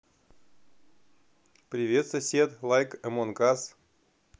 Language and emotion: Russian, positive